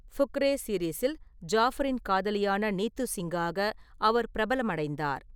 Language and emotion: Tamil, neutral